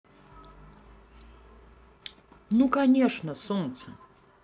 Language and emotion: Russian, positive